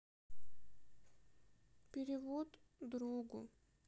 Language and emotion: Russian, sad